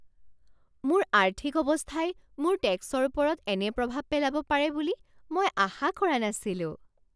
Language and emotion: Assamese, surprised